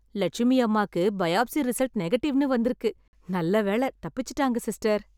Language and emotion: Tamil, happy